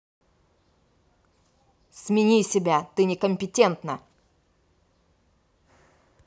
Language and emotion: Russian, angry